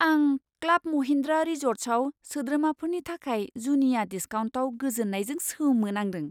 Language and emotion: Bodo, surprised